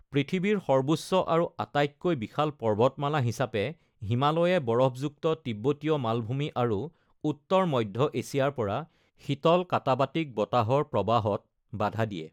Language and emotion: Assamese, neutral